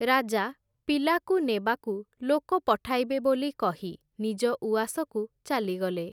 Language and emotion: Odia, neutral